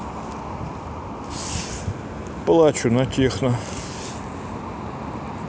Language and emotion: Russian, sad